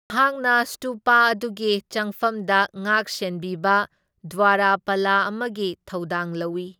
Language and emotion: Manipuri, neutral